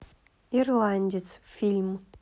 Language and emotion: Russian, neutral